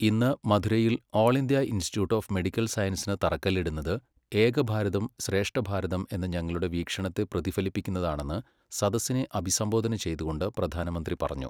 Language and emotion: Malayalam, neutral